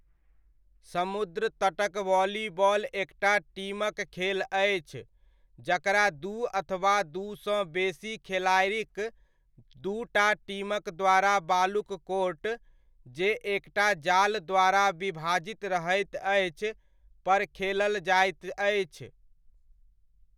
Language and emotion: Maithili, neutral